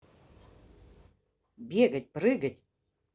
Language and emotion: Russian, neutral